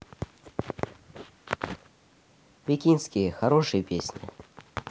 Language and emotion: Russian, neutral